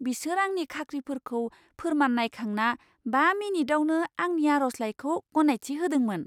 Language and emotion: Bodo, surprised